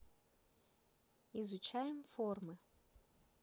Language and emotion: Russian, neutral